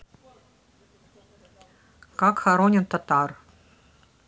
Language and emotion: Russian, neutral